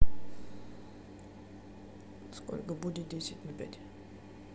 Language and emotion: Russian, neutral